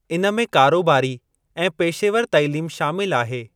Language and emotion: Sindhi, neutral